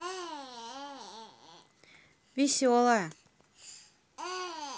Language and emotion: Russian, positive